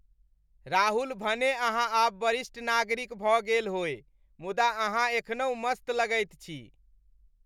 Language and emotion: Maithili, happy